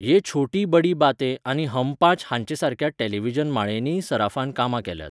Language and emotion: Goan Konkani, neutral